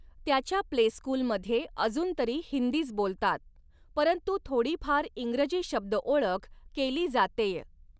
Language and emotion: Marathi, neutral